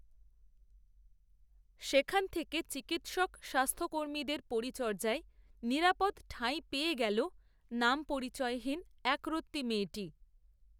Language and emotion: Bengali, neutral